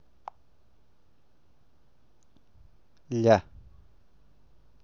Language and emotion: Russian, positive